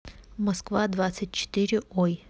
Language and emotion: Russian, neutral